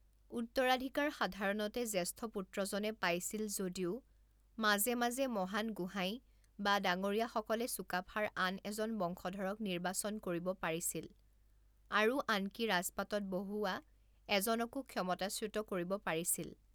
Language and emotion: Assamese, neutral